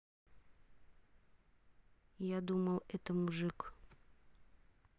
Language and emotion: Russian, neutral